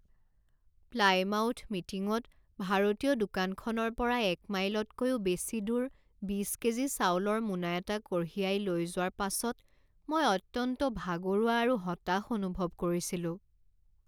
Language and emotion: Assamese, sad